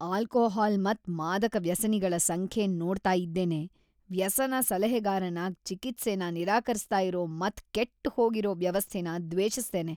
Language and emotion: Kannada, disgusted